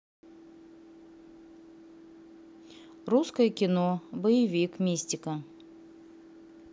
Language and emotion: Russian, neutral